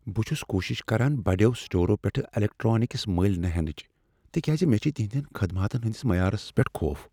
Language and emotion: Kashmiri, fearful